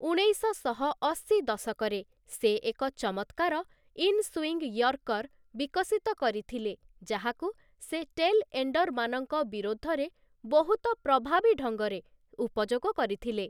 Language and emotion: Odia, neutral